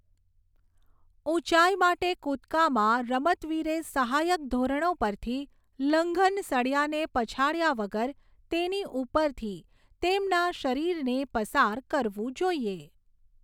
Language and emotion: Gujarati, neutral